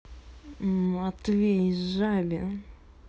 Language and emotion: Russian, angry